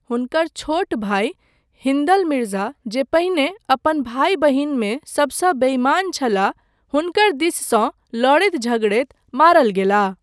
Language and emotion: Maithili, neutral